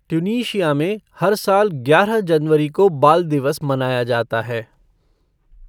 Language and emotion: Hindi, neutral